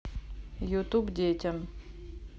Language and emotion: Russian, neutral